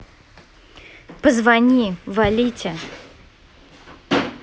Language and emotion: Russian, neutral